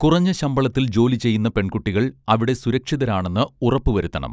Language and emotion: Malayalam, neutral